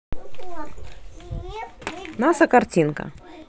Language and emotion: Russian, neutral